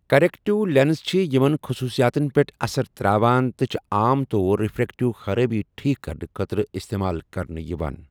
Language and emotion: Kashmiri, neutral